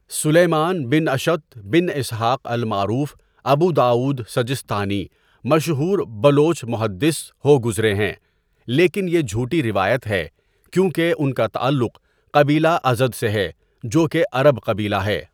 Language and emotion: Urdu, neutral